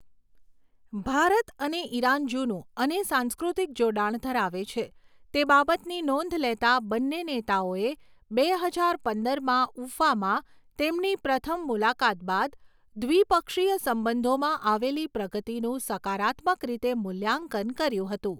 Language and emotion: Gujarati, neutral